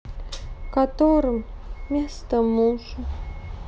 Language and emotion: Russian, sad